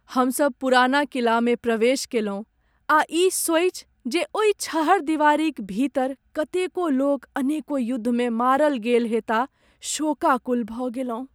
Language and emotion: Maithili, sad